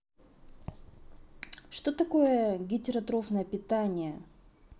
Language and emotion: Russian, neutral